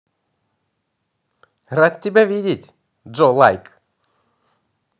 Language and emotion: Russian, positive